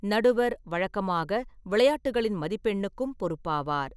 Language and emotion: Tamil, neutral